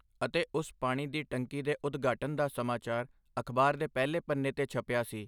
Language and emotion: Punjabi, neutral